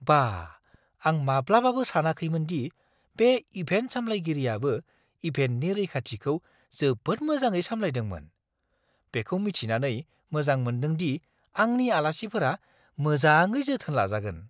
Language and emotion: Bodo, surprised